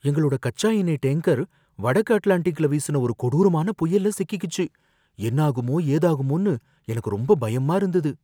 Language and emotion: Tamil, fearful